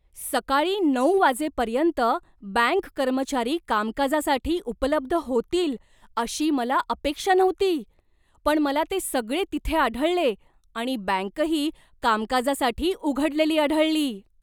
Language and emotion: Marathi, surprised